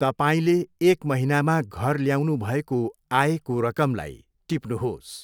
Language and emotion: Nepali, neutral